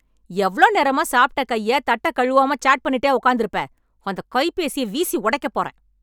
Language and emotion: Tamil, angry